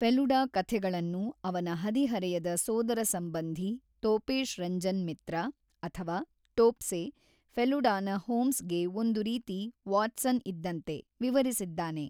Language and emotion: Kannada, neutral